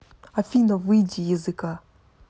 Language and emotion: Russian, angry